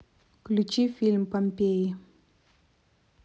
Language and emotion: Russian, neutral